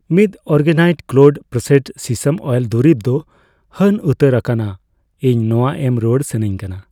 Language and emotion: Santali, neutral